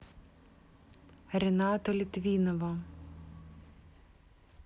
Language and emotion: Russian, neutral